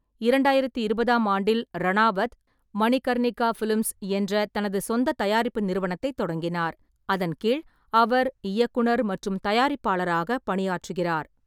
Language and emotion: Tamil, neutral